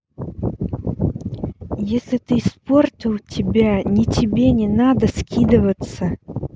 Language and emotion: Russian, angry